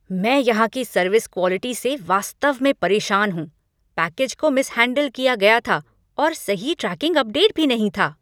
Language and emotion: Hindi, angry